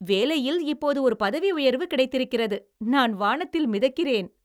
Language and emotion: Tamil, happy